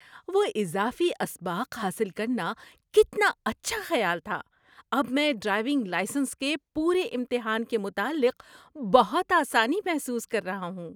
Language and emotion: Urdu, happy